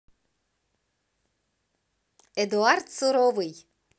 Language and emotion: Russian, positive